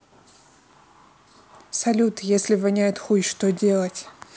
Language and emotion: Russian, neutral